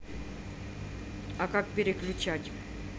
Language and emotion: Russian, neutral